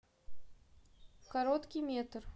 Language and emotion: Russian, neutral